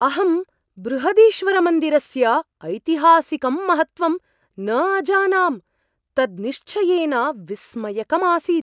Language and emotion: Sanskrit, surprised